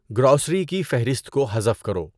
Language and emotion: Urdu, neutral